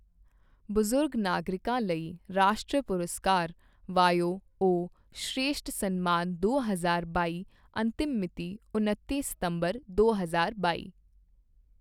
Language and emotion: Punjabi, neutral